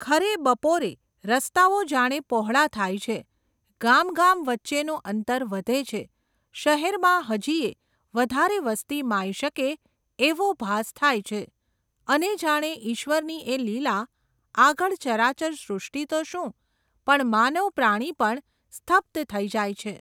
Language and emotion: Gujarati, neutral